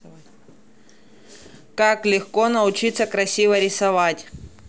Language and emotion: Russian, neutral